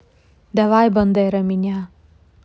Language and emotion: Russian, neutral